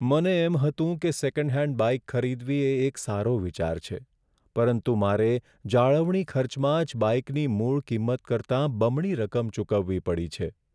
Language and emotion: Gujarati, sad